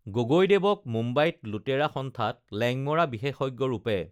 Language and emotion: Assamese, neutral